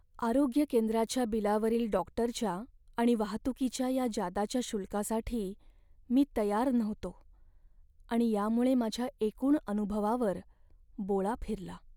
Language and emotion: Marathi, sad